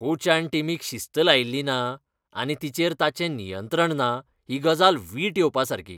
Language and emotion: Goan Konkani, disgusted